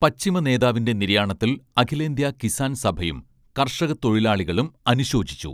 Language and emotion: Malayalam, neutral